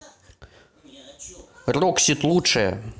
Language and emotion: Russian, positive